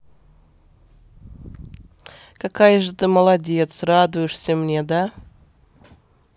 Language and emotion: Russian, positive